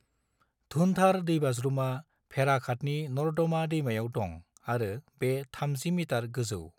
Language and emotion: Bodo, neutral